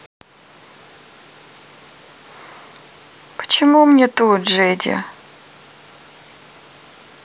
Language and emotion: Russian, sad